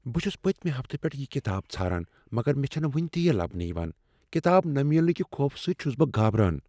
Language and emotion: Kashmiri, fearful